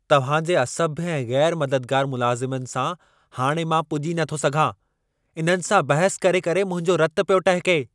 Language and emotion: Sindhi, angry